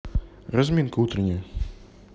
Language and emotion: Russian, neutral